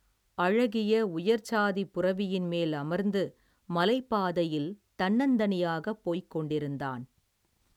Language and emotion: Tamil, neutral